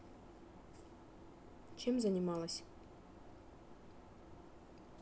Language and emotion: Russian, neutral